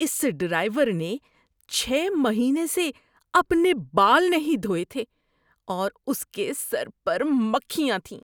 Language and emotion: Urdu, disgusted